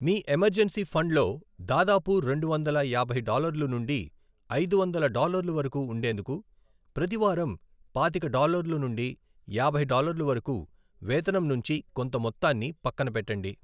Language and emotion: Telugu, neutral